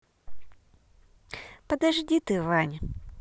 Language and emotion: Russian, positive